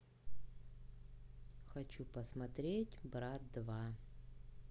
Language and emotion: Russian, neutral